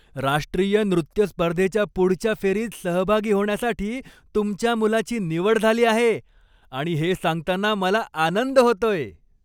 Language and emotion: Marathi, happy